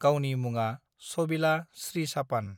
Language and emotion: Bodo, neutral